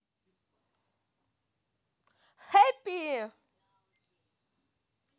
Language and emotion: Russian, positive